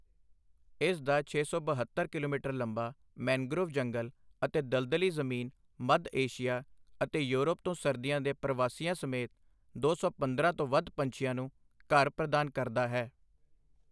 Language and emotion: Punjabi, neutral